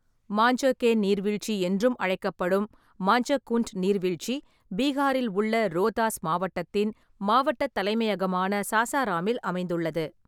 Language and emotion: Tamil, neutral